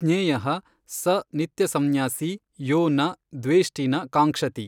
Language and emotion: Kannada, neutral